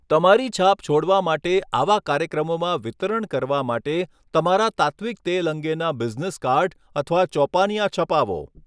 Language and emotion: Gujarati, neutral